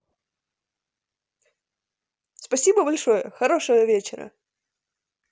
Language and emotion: Russian, positive